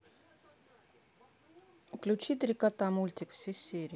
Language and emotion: Russian, neutral